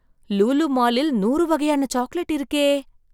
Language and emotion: Tamil, surprised